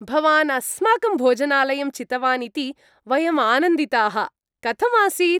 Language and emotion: Sanskrit, happy